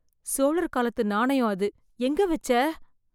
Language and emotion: Tamil, fearful